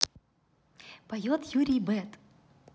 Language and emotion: Russian, positive